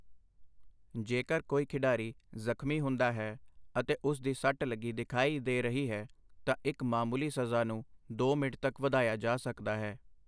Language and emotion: Punjabi, neutral